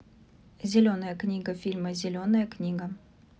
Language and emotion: Russian, neutral